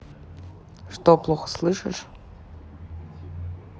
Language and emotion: Russian, neutral